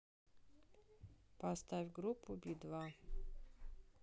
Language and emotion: Russian, neutral